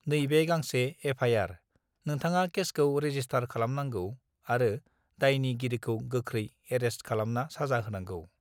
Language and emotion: Bodo, neutral